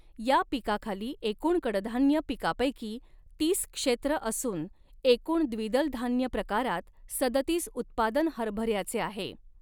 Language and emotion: Marathi, neutral